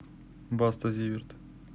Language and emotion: Russian, neutral